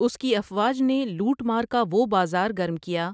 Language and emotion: Urdu, neutral